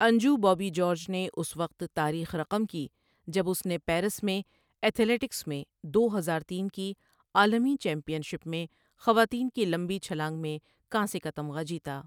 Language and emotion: Urdu, neutral